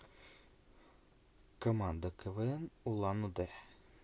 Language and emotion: Russian, neutral